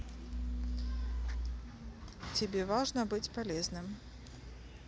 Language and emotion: Russian, neutral